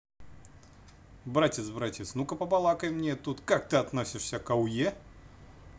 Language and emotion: Russian, positive